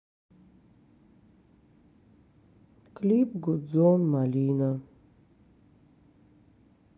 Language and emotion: Russian, sad